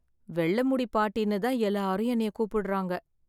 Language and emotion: Tamil, sad